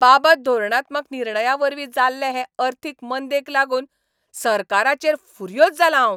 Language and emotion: Goan Konkani, angry